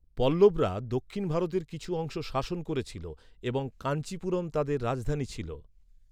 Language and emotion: Bengali, neutral